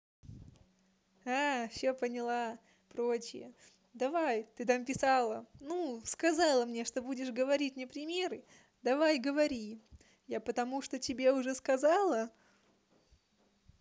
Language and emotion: Russian, positive